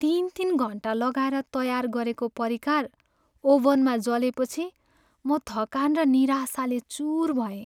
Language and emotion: Nepali, sad